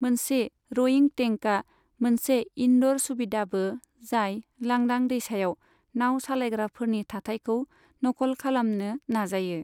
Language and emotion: Bodo, neutral